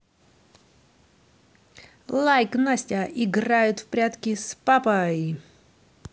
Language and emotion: Russian, positive